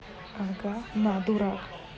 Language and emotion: Russian, neutral